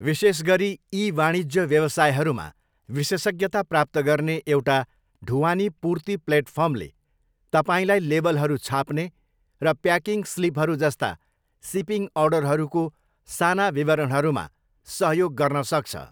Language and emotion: Nepali, neutral